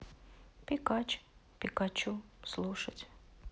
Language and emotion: Russian, sad